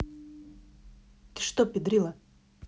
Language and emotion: Russian, angry